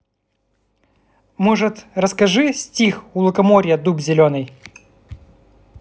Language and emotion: Russian, positive